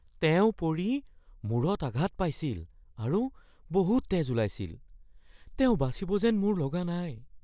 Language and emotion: Assamese, fearful